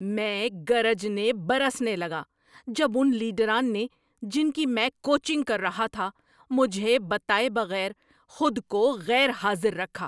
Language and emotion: Urdu, angry